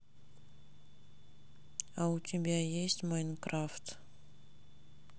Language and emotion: Russian, sad